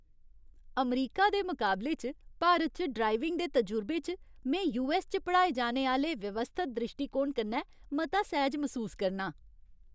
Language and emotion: Dogri, happy